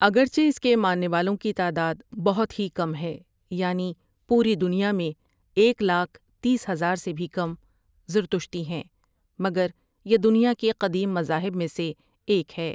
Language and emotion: Urdu, neutral